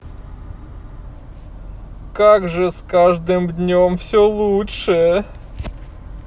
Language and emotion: Russian, sad